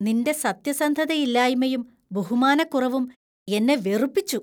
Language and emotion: Malayalam, disgusted